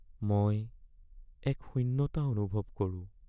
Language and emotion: Assamese, sad